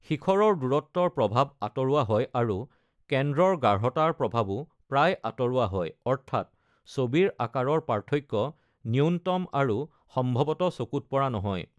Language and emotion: Assamese, neutral